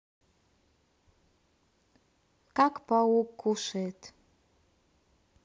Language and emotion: Russian, neutral